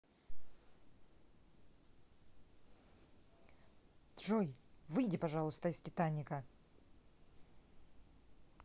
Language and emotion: Russian, angry